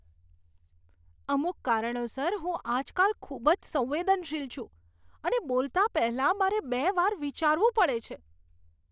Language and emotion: Gujarati, disgusted